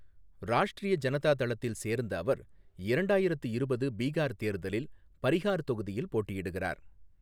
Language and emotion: Tamil, neutral